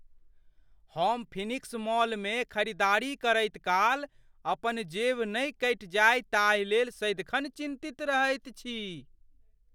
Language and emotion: Maithili, fearful